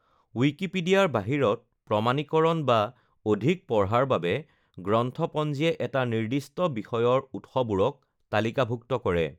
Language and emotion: Assamese, neutral